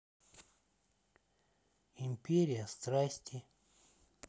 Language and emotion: Russian, neutral